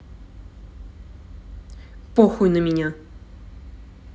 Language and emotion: Russian, angry